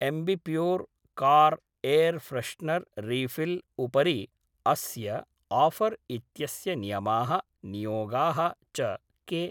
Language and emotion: Sanskrit, neutral